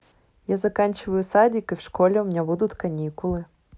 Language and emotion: Russian, positive